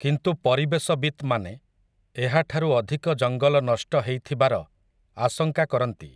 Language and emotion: Odia, neutral